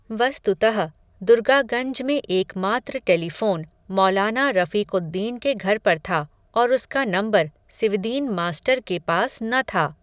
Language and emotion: Hindi, neutral